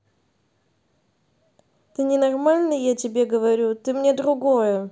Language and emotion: Russian, neutral